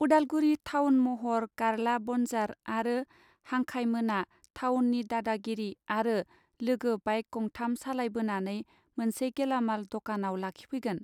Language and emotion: Bodo, neutral